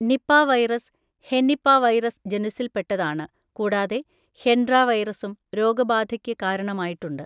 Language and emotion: Malayalam, neutral